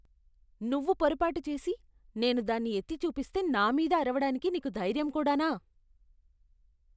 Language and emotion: Telugu, disgusted